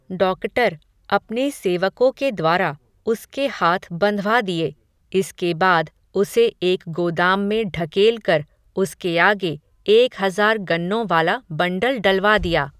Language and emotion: Hindi, neutral